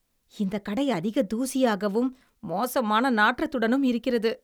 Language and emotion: Tamil, disgusted